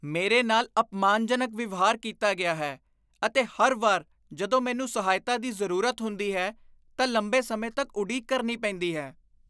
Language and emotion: Punjabi, disgusted